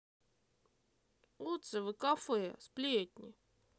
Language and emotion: Russian, positive